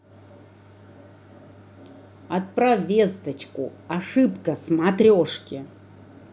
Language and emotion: Russian, angry